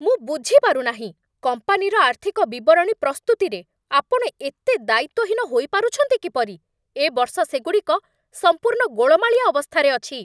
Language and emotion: Odia, angry